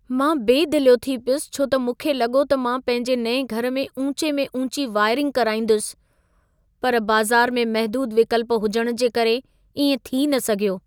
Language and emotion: Sindhi, sad